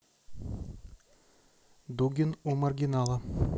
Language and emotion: Russian, neutral